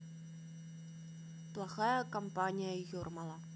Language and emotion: Russian, neutral